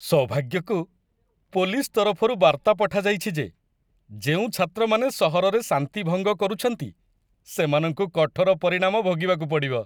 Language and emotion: Odia, happy